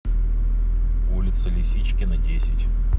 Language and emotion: Russian, neutral